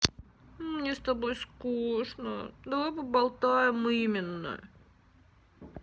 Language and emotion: Russian, sad